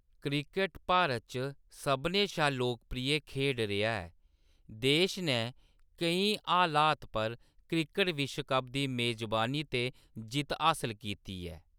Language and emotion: Dogri, neutral